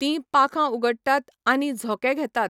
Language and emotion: Goan Konkani, neutral